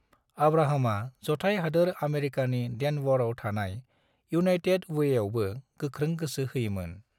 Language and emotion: Bodo, neutral